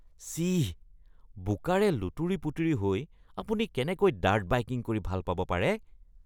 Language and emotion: Assamese, disgusted